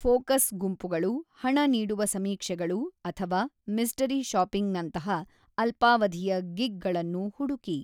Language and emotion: Kannada, neutral